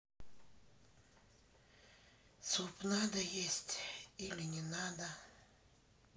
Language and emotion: Russian, sad